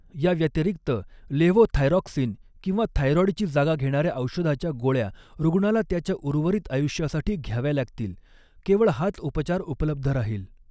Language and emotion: Marathi, neutral